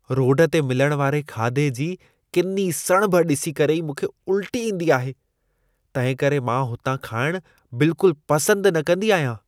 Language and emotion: Sindhi, disgusted